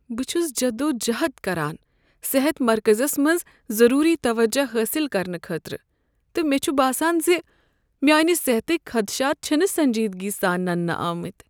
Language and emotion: Kashmiri, sad